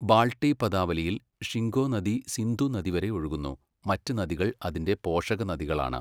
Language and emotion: Malayalam, neutral